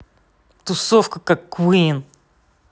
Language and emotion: Russian, angry